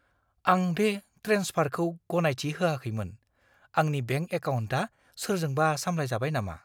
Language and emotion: Bodo, fearful